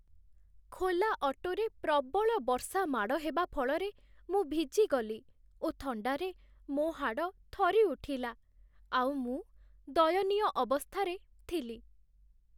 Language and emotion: Odia, sad